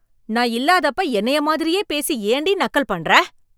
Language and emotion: Tamil, angry